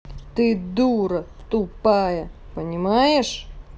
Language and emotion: Russian, angry